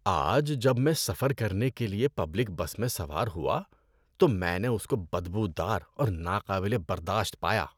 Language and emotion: Urdu, disgusted